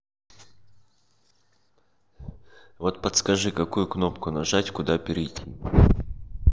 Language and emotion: Russian, neutral